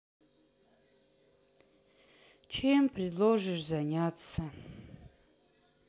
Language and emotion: Russian, sad